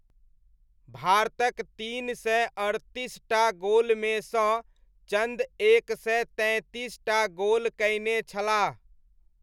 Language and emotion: Maithili, neutral